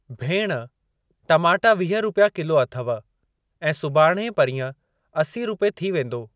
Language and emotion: Sindhi, neutral